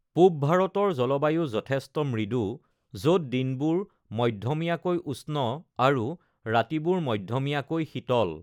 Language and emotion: Assamese, neutral